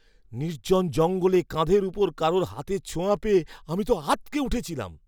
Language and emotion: Bengali, surprised